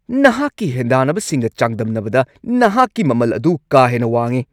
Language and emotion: Manipuri, angry